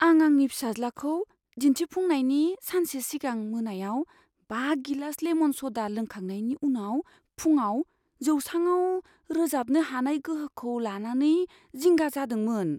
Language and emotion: Bodo, fearful